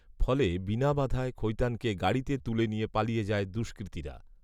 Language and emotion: Bengali, neutral